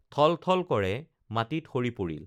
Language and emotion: Assamese, neutral